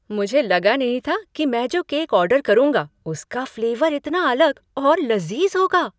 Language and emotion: Hindi, surprised